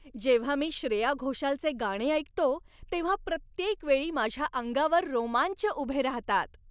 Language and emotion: Marathi, happy